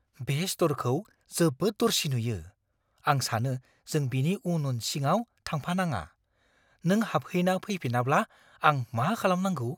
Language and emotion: Bodo, fearful